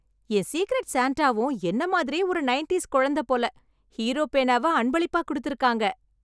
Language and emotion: Tamil, happy